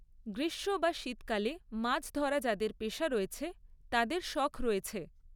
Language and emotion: Bengali, neutral